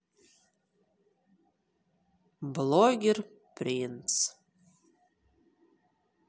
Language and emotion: Russian, sad